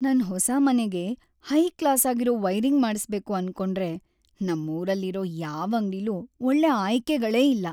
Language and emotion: Kannada, sad